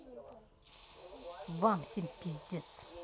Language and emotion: Russian, angry